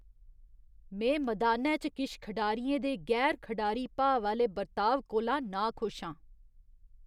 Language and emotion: Dogri, disgusted